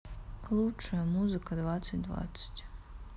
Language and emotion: Russian, sad